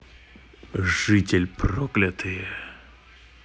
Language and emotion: Russian, angry